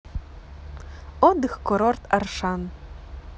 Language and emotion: Russian, positive